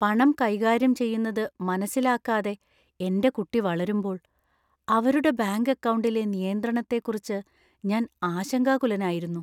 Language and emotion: Malayalam, fearful